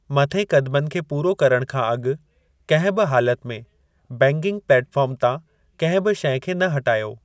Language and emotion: Sindhi, neutral